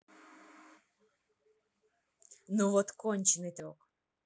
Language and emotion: Russian, neutral